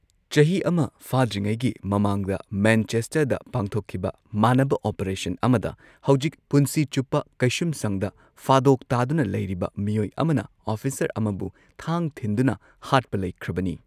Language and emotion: Manipuri, neutral